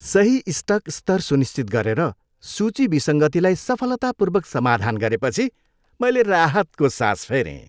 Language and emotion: Nepali, happy